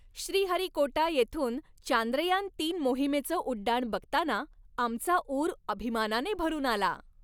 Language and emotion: Marathi, happy